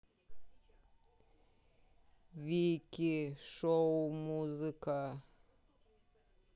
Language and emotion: Russian, neutral